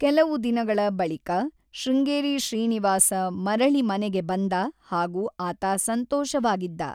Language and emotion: Kannada, neutral